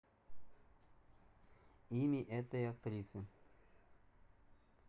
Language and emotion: Russian, neutral